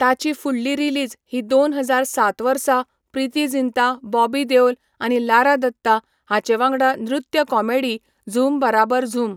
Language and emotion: Goan Konkani, neutral